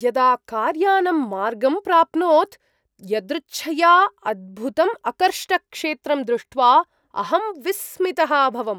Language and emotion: Sanskrit, surprised